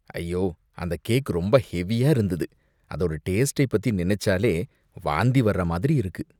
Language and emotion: Tamil, disgusted